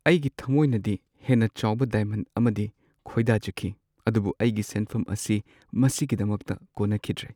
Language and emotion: Manipuri, sad